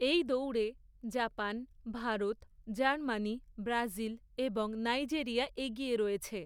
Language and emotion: Bengali, neutral